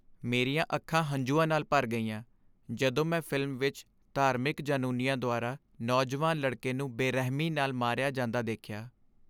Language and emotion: Punjabi, sad